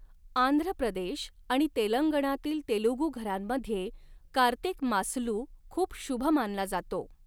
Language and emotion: Marathi, neutral